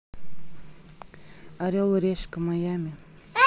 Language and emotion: Russian, neutral